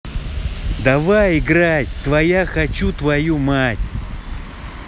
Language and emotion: Russian, angry